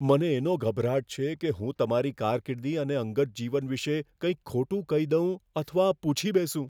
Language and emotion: Gujarati, fearful